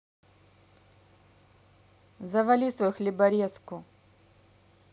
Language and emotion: Russian, angry